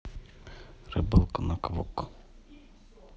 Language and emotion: Russian, neutral